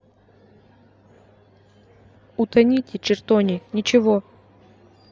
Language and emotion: Russian, neutral